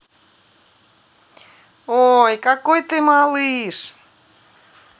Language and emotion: Russian, positive